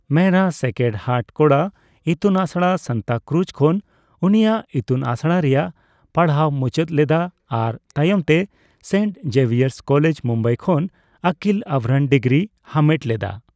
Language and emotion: Santali, neutral